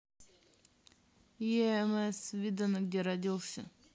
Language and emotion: Russian, neutral